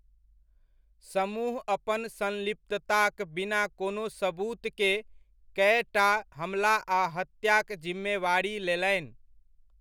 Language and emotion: Maithili, neutral